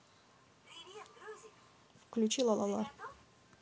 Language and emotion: Russian, neutral